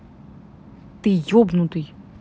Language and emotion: Russian, angry